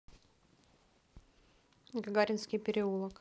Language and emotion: Russian, neutral